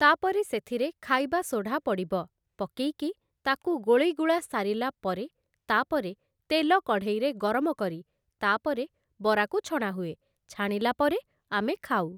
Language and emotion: Odia, neutral